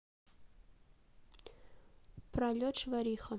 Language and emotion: Russian, neutral